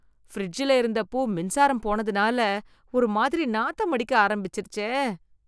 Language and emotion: Tamil, disgusted